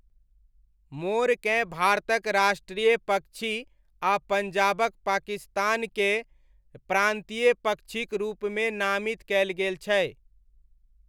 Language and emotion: Maithili, neutral